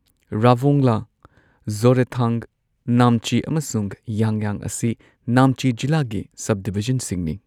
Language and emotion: Manipuri, neutral